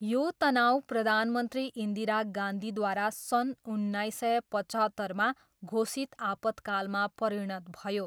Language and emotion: Nepali, neutral